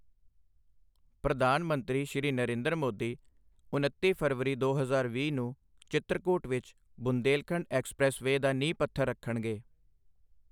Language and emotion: Punjabi, neutral